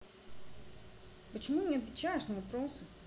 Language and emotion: Russian, neutral